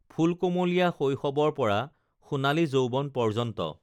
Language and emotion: Assamese, neutral